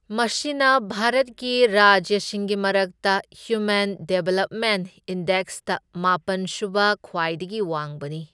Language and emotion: Manipuri, neutral